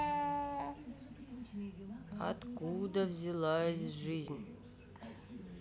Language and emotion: Russian, sad